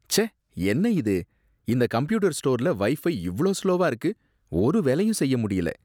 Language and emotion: Tamil, disgusted